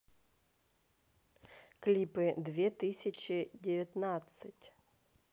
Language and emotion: Russian, neutral